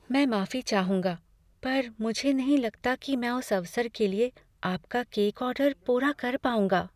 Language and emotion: Hindi, fearful